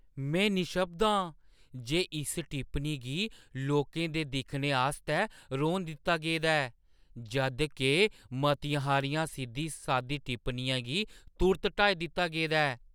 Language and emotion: Dogri, surprised